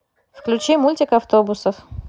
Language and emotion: Russian, neutral